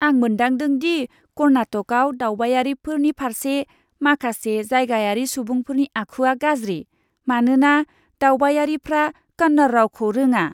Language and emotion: Bodo, disgusted